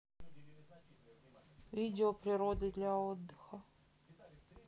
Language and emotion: Russian, neutral